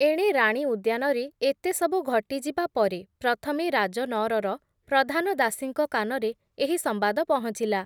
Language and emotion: Odia, neutral